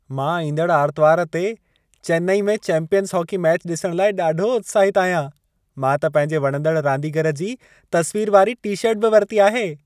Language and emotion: Sindhi, happy